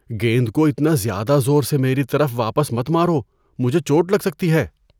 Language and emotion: Urdu, fearful